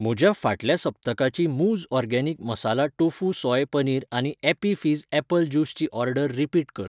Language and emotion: Goan Konkani, neutral